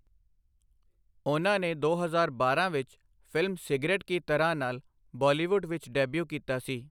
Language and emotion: Punjabi, neutral